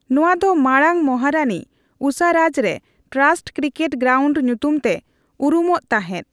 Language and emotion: Santali, neutral